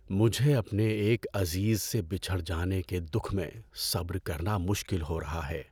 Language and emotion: Urdu, sad